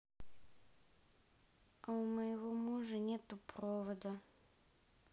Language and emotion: Russian, sad